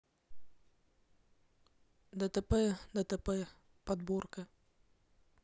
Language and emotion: Russian, neutral